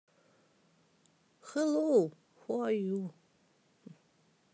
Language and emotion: Russian, neutral